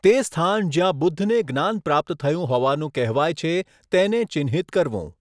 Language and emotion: Gujarati, neutral